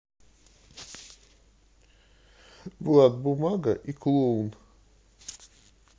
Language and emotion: Russian, neutral